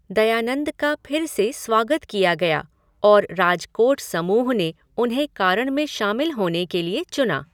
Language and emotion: Hindi, neutral